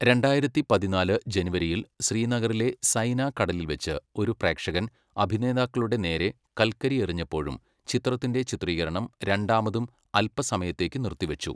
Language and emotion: Malayalam, neutral